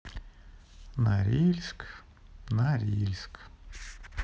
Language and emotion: Russian, sad